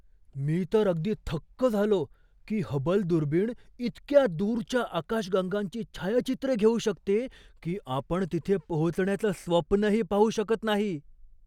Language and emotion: Marathi, surprised